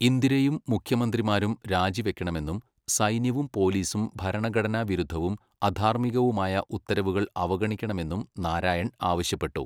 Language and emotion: Malayalam, neutral